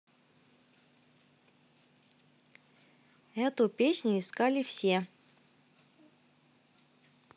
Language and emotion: Russian, positive